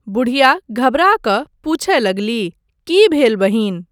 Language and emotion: Maithili, neutral